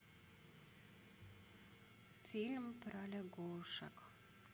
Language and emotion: Russian, sad